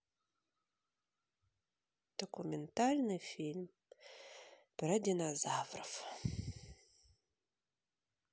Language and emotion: Russian, sad